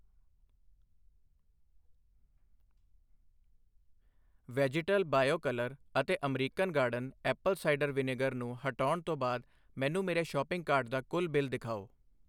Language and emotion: Punjabi, neutral